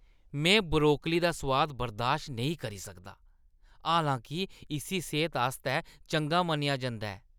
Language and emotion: Dogri, disgusted